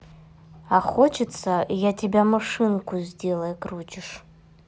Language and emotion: Russian, neutral